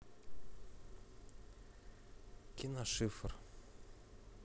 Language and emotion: Russian, neutral